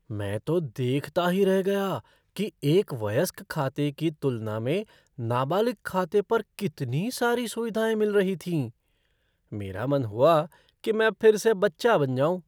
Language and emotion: Hindi, surprised